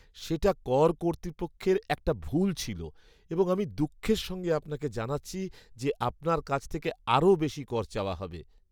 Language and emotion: Bengali, sad